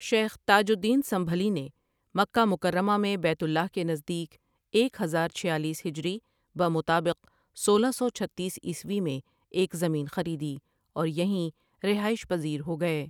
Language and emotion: Urdu, neutral